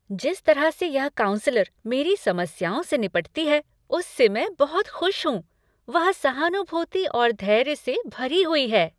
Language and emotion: Hindi, happy